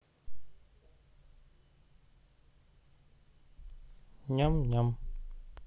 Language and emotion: Russian, neutral